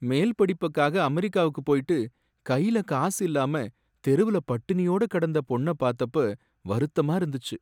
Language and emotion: Tamil, sad